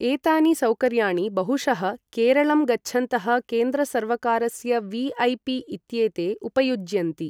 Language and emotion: Sanskrit, neutral